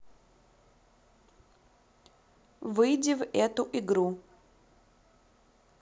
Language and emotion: Russian, neutral